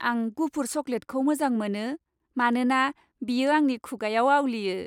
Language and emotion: Bodo, happy